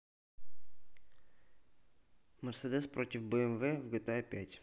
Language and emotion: Russian, neutral